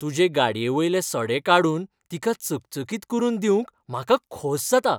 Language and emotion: Goan Konkani, happy